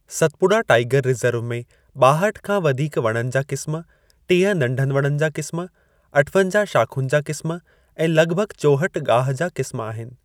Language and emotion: Sindhi, neutral